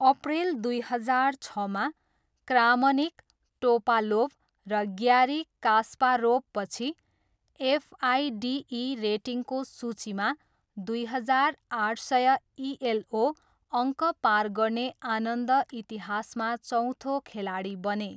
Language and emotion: Nepali, neutral